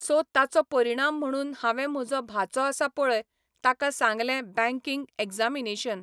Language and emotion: Goan Konkani, neutral